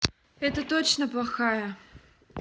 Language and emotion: Russian, sad